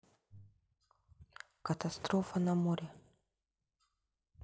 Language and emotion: Russian, sad